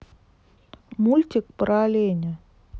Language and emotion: Russian, neutral